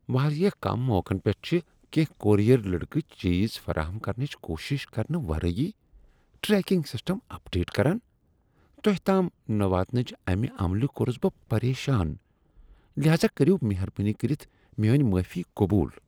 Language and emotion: Kashmiri, disgusted